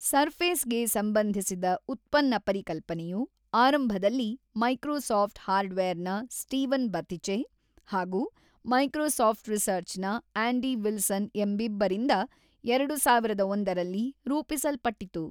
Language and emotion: Kannada, neutral